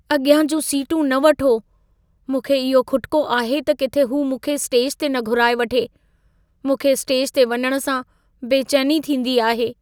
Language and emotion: Sindhi, fearful